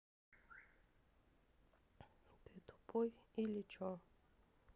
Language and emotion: Russian, sad